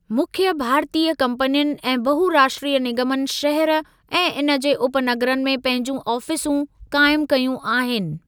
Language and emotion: Sindhi, neutral